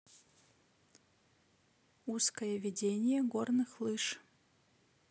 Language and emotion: Russian, neutral